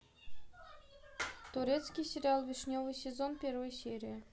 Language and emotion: Russian, neutral